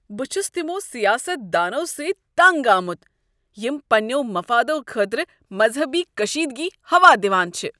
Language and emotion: Kashmiri, disgusted